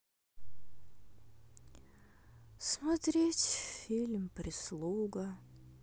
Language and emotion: Russian, sad